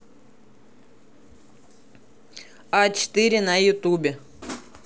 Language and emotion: Russian, neutral